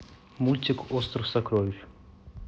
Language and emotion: Russian, neutral